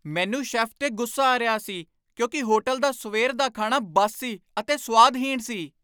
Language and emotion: Punjabi, angry